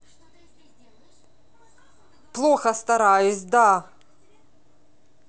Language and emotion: Russian, angry